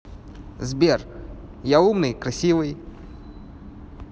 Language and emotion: Russian, positive